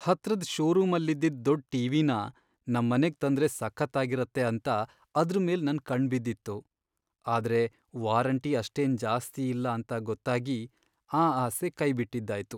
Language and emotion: Kannada, sad